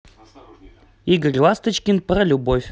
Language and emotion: Russian, positive